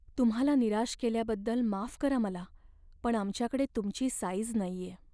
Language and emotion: Marathi, sad